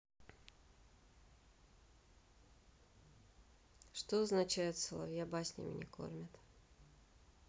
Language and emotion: Russian, neutral